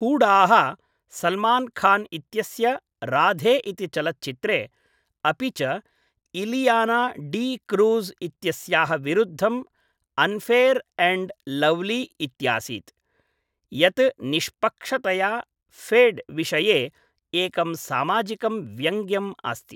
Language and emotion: Sanskrit, neutral